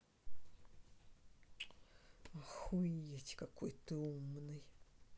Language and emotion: Russian, neutral